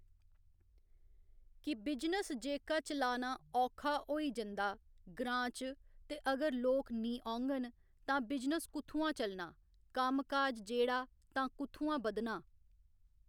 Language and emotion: Dogri, neutral